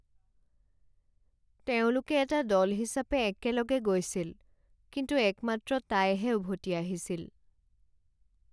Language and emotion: Assamese, sad